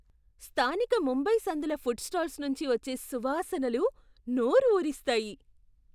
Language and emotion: Telugu, surprised